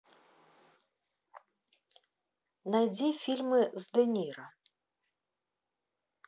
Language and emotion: Russian, neutral